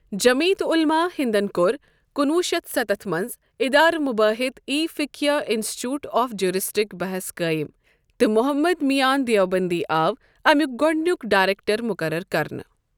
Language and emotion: Kashmiri, neutral